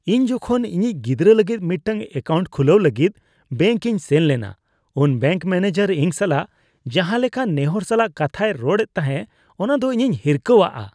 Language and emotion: Santali, disgusted